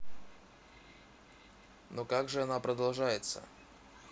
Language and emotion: Russian, neutral